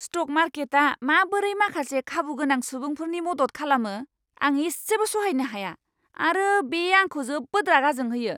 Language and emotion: Bodo, angry